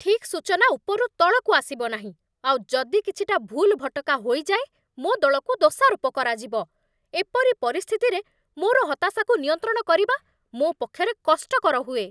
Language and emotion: Odia, angry